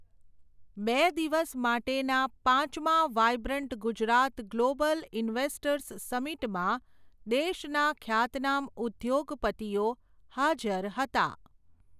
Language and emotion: Gujarati, neutral